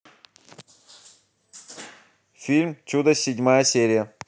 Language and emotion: Russian, neutral